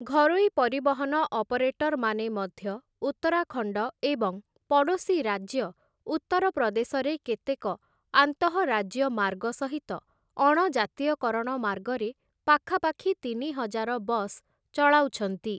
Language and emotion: Odia, neutral